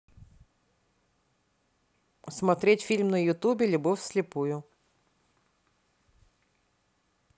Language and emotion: Russian, neutral